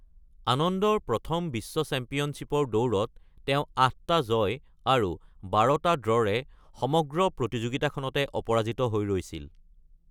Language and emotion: Assamese, neutral